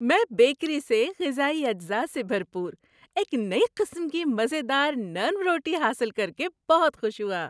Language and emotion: Urdu, happy